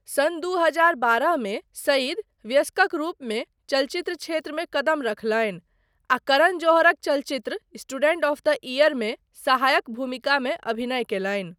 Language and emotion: Maithili, neutral